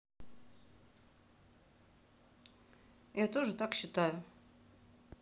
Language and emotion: Russian, neutral